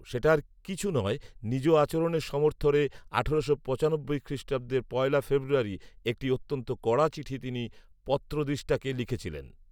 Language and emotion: Bengali, neutral